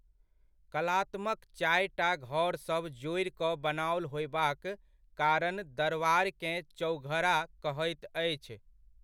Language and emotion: Maithili, neutral